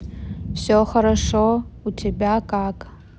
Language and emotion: Russian, neutral